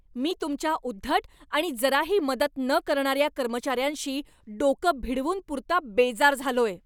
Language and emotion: Marathi, angry